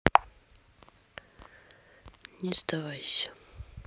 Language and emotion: Russian, sad